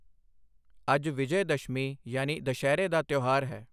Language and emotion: Punjabi, neutral